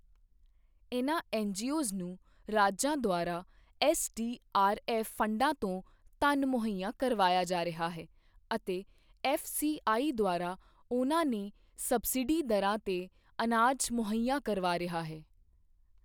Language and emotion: Punjabi, neutral